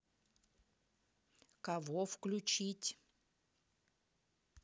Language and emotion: Russian, angry